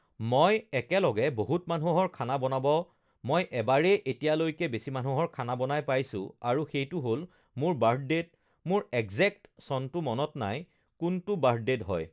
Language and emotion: Assamese, neutral